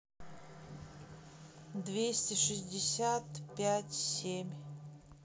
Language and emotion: Russian, neutral